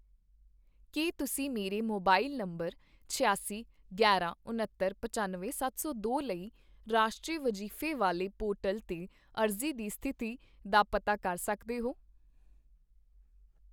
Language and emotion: Punjabi, neutral